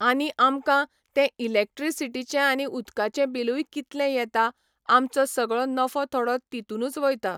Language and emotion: Goan Konkani, neutral